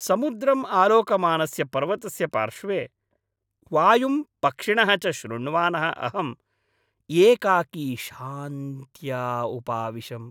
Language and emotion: Sanskrit, happy